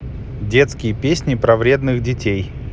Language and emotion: Russian, neutral